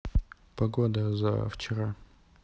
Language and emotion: Russian, neutral